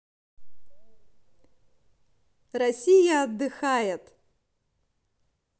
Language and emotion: Russian, positive